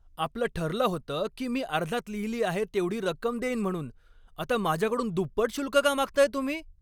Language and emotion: Marathi, angry